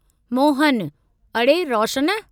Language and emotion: Sindhi, neutral